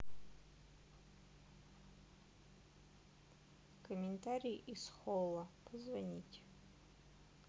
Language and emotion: Russian, neutral